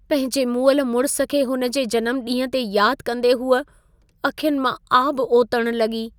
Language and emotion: Sindhi, sad